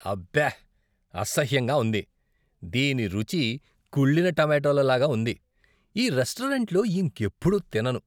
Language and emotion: Telugu, disgusted